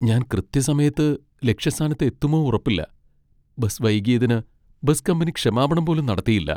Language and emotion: Malayalam, sad